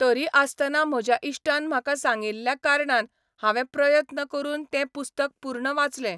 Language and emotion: Goan Konkani, neutral